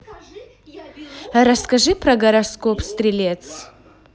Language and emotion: Russian, positive